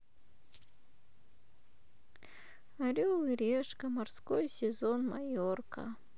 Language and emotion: Russian, sad